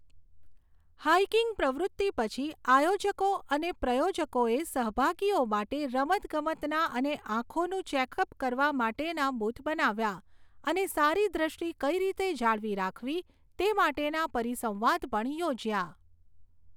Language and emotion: Gujarati, neutral